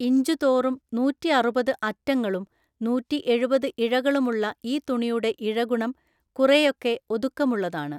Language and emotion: Malayalam, neutral